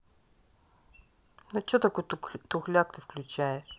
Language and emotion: Russian, angry